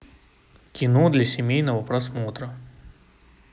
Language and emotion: Russian, neutral